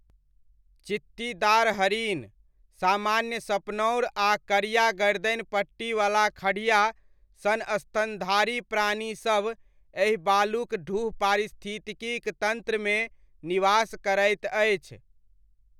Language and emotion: Maithili, neutral